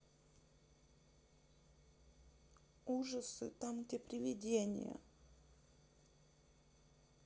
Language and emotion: Russian, neutral